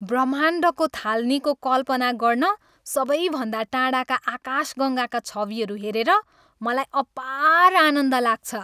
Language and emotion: Nepali, happy